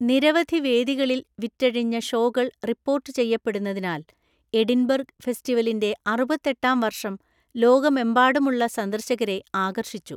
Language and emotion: Malayalam, neutral